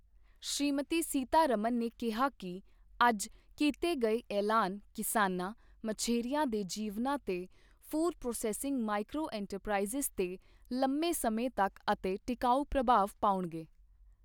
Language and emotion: Punjabi, neutral